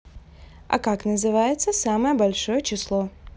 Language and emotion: Russian, neutral